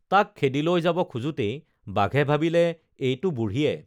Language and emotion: Assamese, neutral